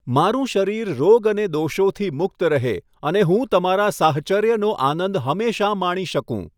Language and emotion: Gujarati, neutral